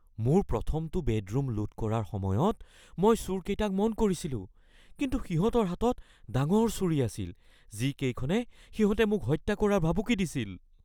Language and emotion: Assamese, fearful